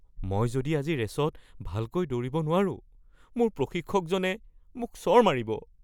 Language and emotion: Assamese, fearful